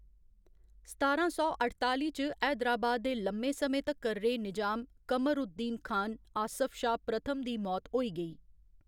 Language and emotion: Dogri, neutral